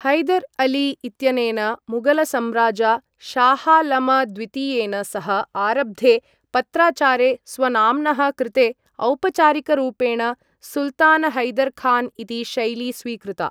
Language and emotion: Sanskrit, neutral